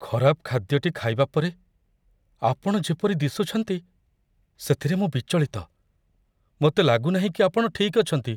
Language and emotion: Odia, fearful